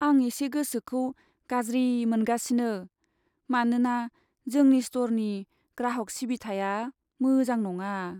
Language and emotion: Bodo, sad